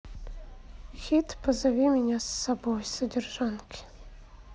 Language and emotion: Russian, sad